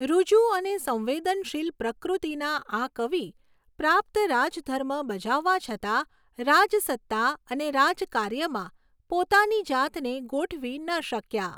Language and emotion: Gujarati, neutral